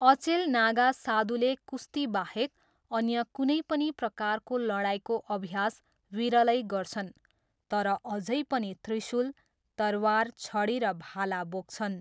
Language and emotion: Nepali, neutral